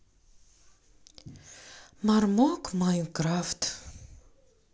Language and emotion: Russian, sad